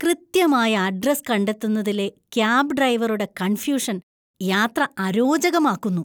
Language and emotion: Malayalam, disgusted